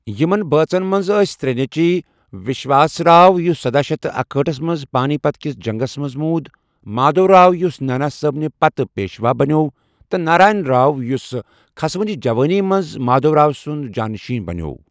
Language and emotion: Kashmiri, neutral